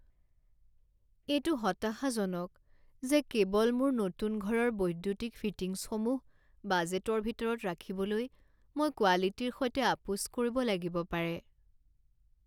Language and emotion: Assamese, sad